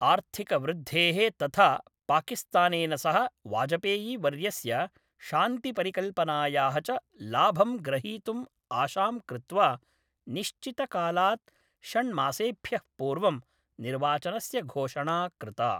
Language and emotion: Sanskrit, neutral